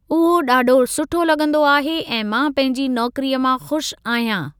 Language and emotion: Sindhi, neutral